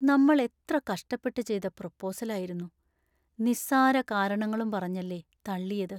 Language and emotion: Malayalam, sad